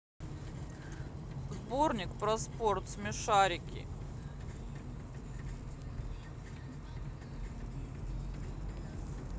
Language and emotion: Russian, neutral